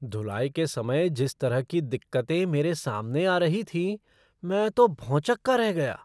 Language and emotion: Hindi, surprised